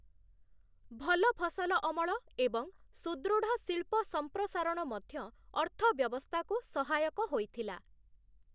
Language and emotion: Odia, neutral